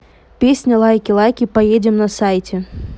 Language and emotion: Russian, neutral